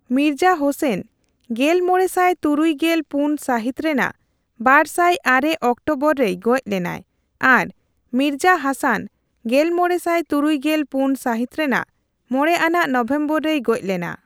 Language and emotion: Santali, neutral